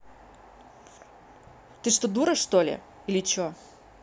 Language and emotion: Russian, angry